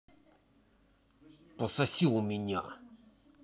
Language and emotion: Russian, angry